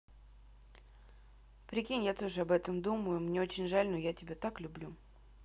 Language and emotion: Russian, neutral